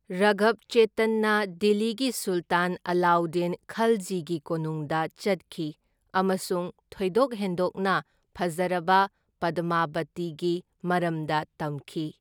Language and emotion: Manipuri, neutral